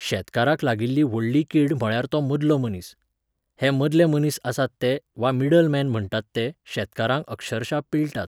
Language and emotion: Goan Konkani, neutral